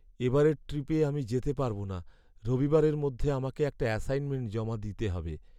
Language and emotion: Bengali, sad